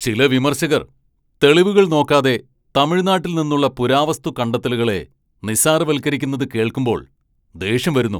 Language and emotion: Malayalam, angry